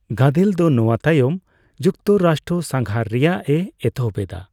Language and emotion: Santali, neutral